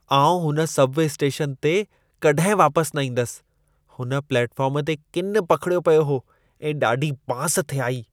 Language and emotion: Sindhi, disgusted